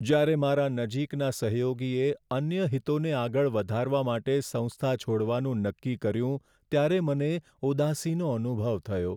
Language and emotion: Gujarati, sad